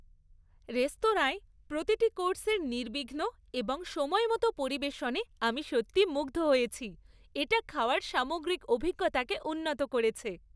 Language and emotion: Bengali, happy